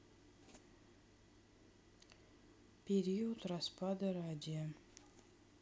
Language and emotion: Russian, neutral